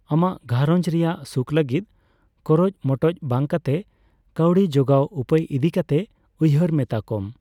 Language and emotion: Santali, neutral